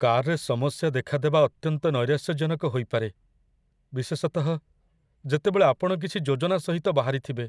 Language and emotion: Odia, sad